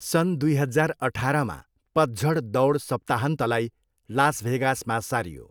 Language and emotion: Nepali, neutral